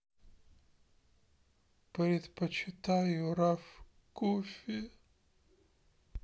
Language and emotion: Russian, sad